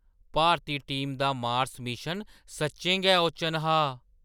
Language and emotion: Dogri, surprised